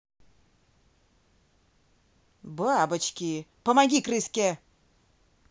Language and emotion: Russian, angry